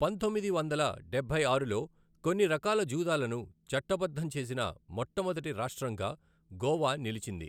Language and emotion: Telugu, neutral